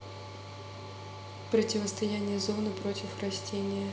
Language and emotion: Russian, neutral